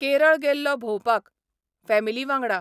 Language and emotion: Goan Konkani, neutral